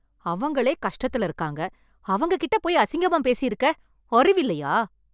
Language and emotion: Tamil, angry